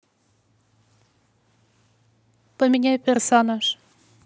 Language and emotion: Russian, neutral